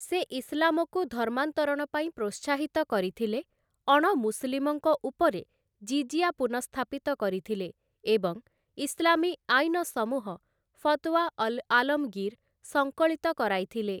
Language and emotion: Odia, neutral